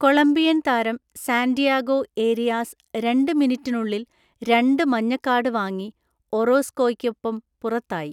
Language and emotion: Malayalam, neutral